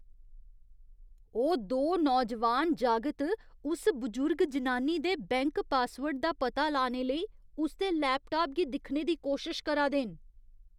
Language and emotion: Dogri, disgusted